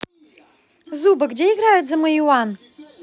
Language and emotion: Russian, positive